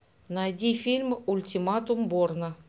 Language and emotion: Russian, neutral